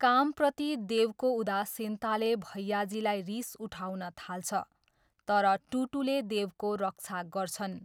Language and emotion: Nepali, neutral